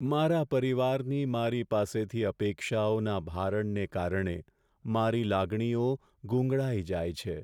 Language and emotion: Gujarati, sad